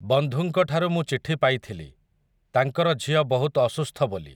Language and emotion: Odia, neutral